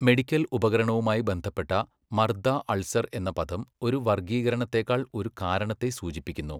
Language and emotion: Malayalam, neutral